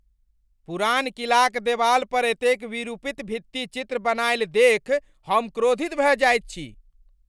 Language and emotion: Maithili, angry